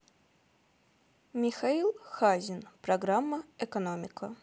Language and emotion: Russian, neutral